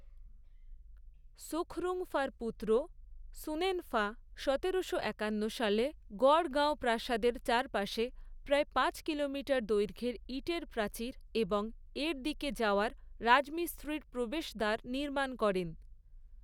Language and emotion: Bengali, neutral